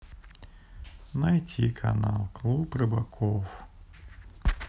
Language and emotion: Russian, sad